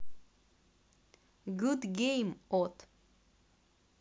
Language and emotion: Russian, neutral